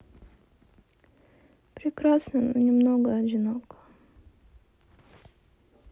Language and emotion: Russian, sad